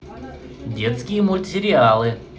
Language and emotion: Russian, positive